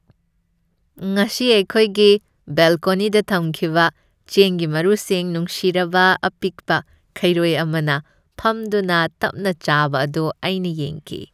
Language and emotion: Manipuri, happy